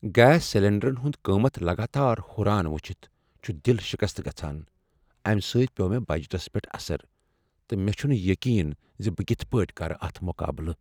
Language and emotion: Kashmiri, sad